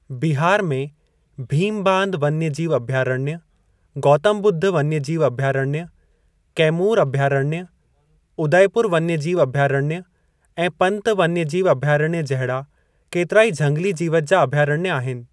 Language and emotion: Sindhi, neutral